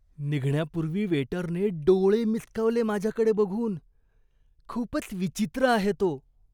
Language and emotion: Marathi, disgusted